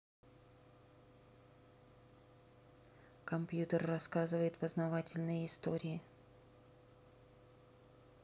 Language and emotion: Russian, neutral